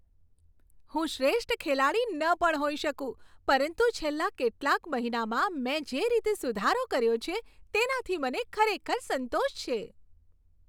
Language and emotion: Gujarati, happy